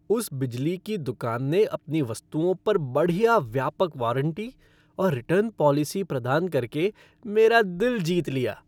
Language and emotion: Hindi, happy